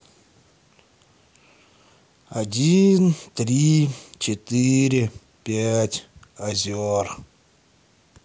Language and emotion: Russian, sad